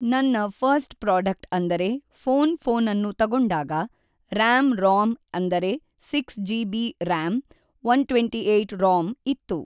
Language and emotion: Kannada, neutral